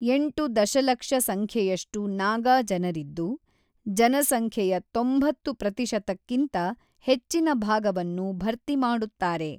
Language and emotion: Kannada, neutral